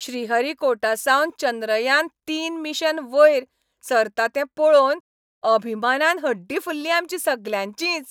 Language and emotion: Goan Konkani, happy